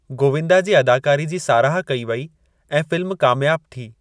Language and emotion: Sindhi, neutral